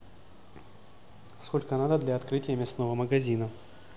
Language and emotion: Russian, neutral